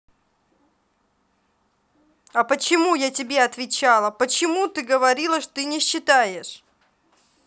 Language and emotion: Russian, angry